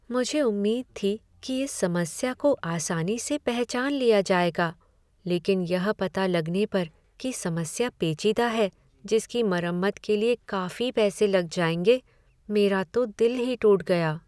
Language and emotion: Hindi, sad